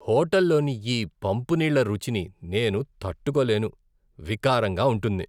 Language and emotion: Telugu, disgusted